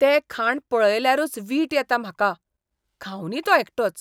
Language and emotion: Goan Konkani, disgusted